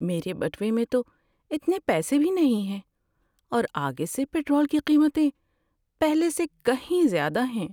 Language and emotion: Urdu, sad